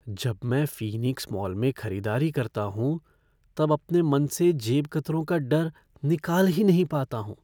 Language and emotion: Hindi, fearful